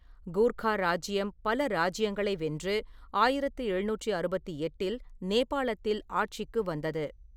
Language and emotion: Tamil, neutral